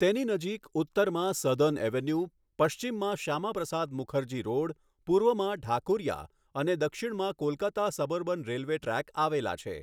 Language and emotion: Gujarati, neutral